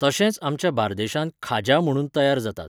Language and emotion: Goan Konkani, neutral